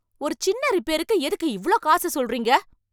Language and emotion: Tamil, angry